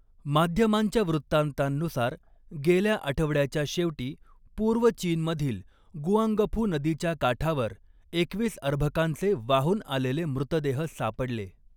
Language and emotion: Marathi, neutral